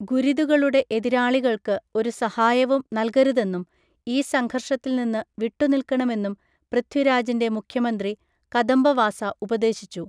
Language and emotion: Malayalam, neutral